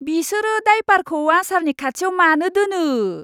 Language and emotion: Bodo, disgusted